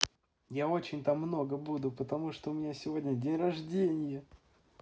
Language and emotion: Russian, positive